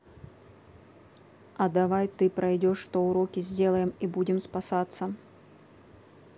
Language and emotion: Russian, neutral